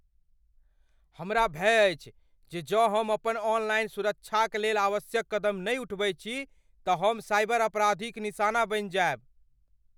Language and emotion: Maithili, fearful